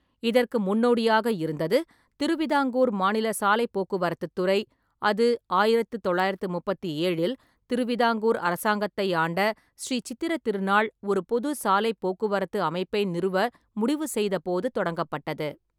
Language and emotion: Tamil, neutral